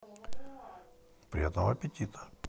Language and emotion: Russian, neutral